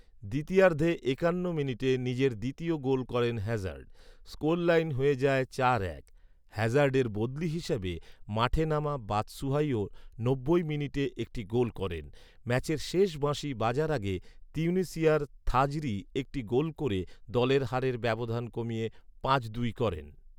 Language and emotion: Bengali, neutral